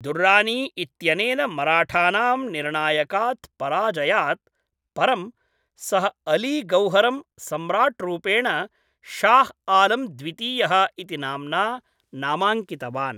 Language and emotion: Sanskrit, neutral